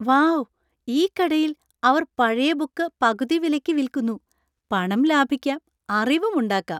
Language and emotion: Malayalam, happy